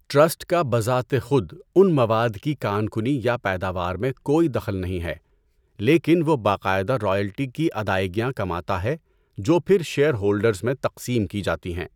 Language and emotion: Urdu, neutral